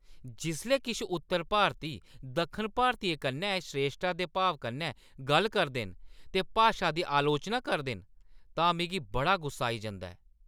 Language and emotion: Dogri, angry